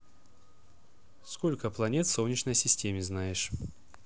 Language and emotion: Russian, neutral